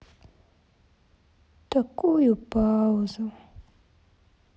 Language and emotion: Russian, sad